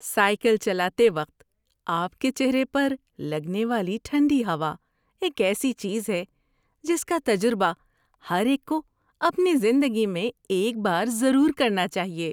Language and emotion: Urdu, happy